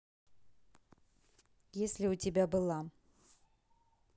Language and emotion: Russian, neutral